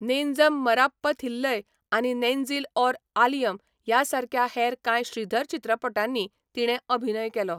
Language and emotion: Goan Konkani, neutral